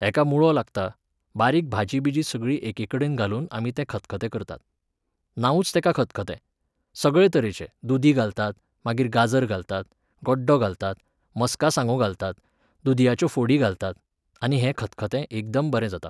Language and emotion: Goan Konkani, neutral